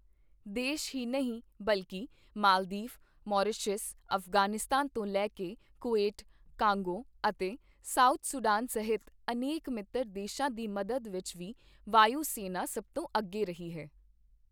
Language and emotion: Punjabi, neutral